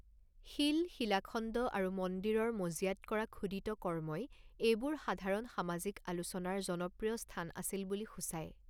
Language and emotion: Assamese, neutral